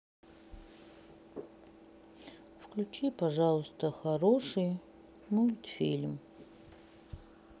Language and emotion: Russian, sad